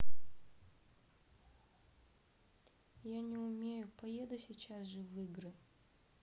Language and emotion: Russian, sad